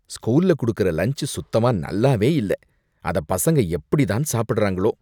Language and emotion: Tamil, disgusted